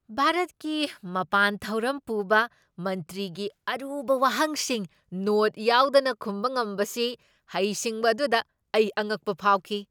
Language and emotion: Manipuri, surprised